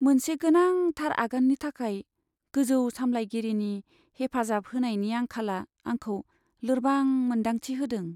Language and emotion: Bodo, sad